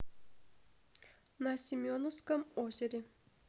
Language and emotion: Russian, neutral